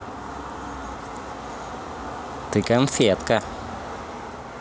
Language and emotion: Russian, positive